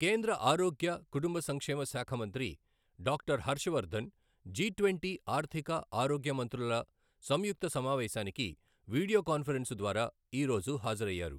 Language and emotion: Telugu, neutral